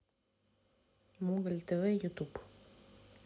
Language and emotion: Russian, neutral